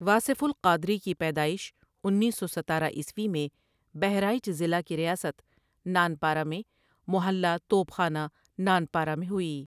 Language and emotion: Urdu, neutral